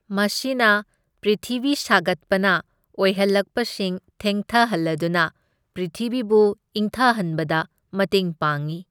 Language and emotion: Manipuri, neutral